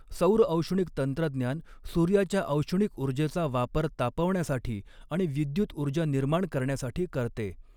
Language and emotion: Marathi, neutral